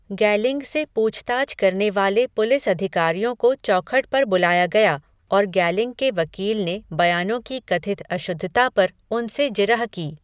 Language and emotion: Hindi, neutral